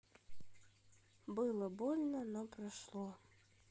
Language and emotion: Russian, sad